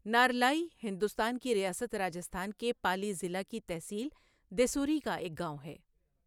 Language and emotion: Urdu, neutral